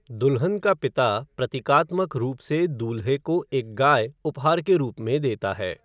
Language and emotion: Hindi, neutral